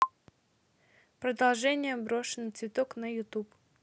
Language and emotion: Russian, neutral